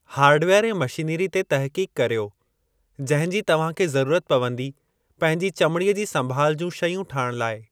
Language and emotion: Sindhi, neutral